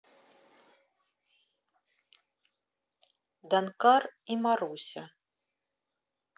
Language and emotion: Russian, neutral